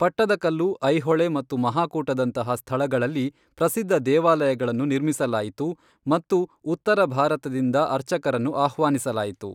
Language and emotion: Kannada, neutral